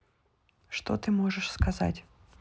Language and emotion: Russian, neutral